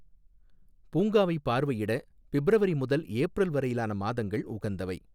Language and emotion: Tamil, neutral